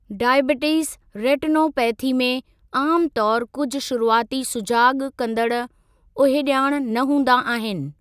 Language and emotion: Sindhi, neutral